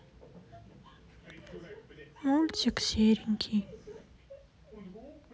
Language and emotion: Russian, sad